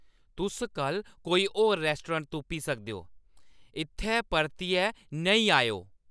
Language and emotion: Dogri, angry